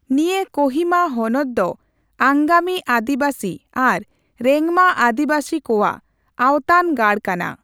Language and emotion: Santali, neutral